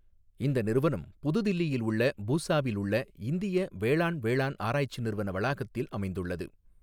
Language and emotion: Tamil, neutral